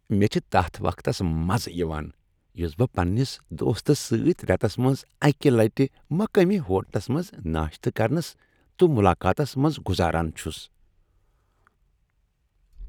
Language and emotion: Kashmiri, happy